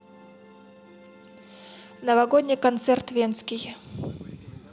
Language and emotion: Russian, neutral